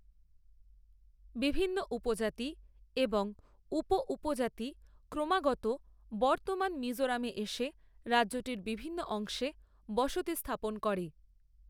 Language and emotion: Bengali, neutral